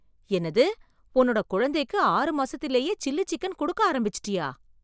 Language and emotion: Tamil, surprised